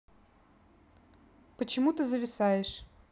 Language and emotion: Russian, neutral